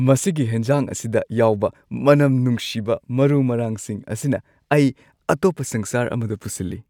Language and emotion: Manipuri, happy